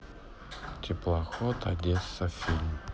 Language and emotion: Russian, sad